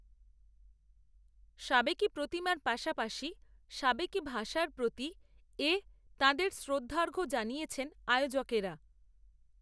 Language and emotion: Bengali, neutral